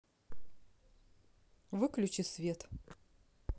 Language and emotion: Russian, neutral